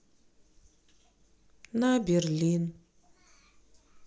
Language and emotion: Russian, sad